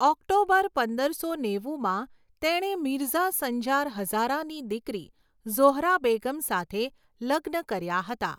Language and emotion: Gujarati, neutral